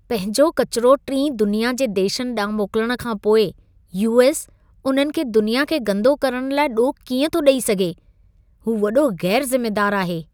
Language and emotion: Sindhi, disgusted